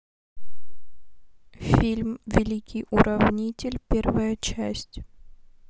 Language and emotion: Russian, neutral